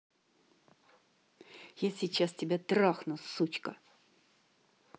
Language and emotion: Russian, angry